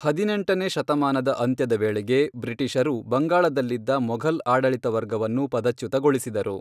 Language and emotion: Kannada, neutral